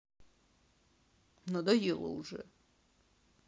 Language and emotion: Russian, sad